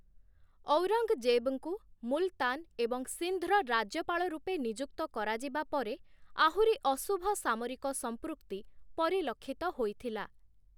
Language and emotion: Odia, neutral